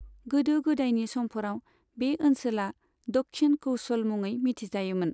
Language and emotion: Bodo, neutral